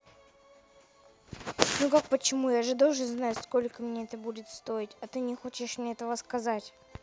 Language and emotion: Russian, neutral